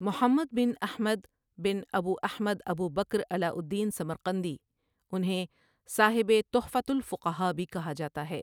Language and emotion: Urdu, neutral